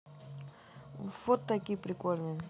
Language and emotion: Russian, neutral